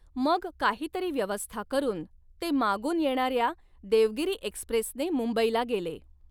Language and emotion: Marathi, neutral